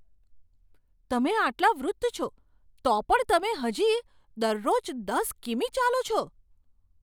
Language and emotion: Gujarati, surprised